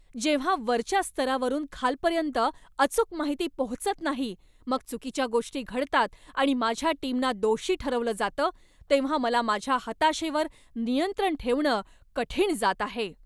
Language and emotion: Marathi, angry